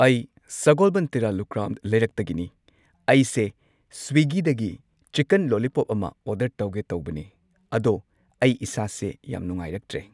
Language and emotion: Manipuri, neutral